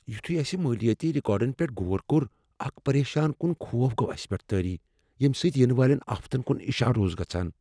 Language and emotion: Kashmiri, fearful